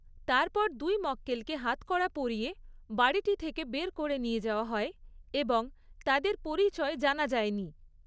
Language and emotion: Bengali, neutral